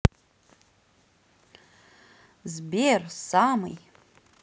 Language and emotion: Russian, positive